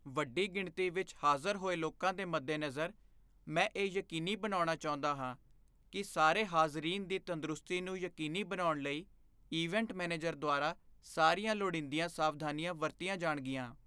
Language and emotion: Punjabi, fearful